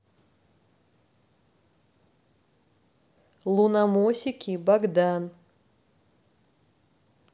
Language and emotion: Russian, neutral